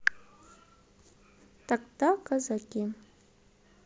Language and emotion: Russian, neutral